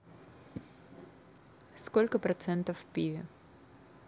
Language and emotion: Russian, neutral